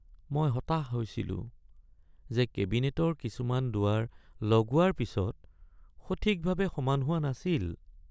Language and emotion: Assamese, sad